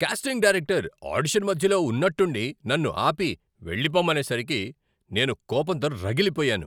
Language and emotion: Telugu, angry